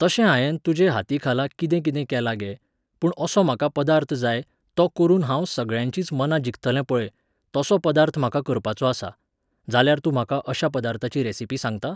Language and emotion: Goan Konkani, neutral